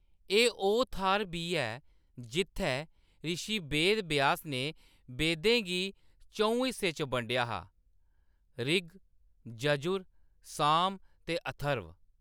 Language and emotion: Dogri, neutral